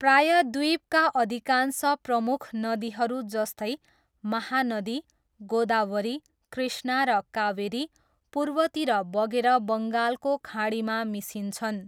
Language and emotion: Nepali, neutral